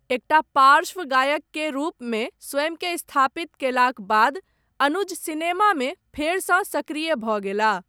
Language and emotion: Maithili, neutral